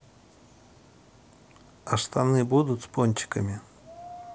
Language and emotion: Russian, neutral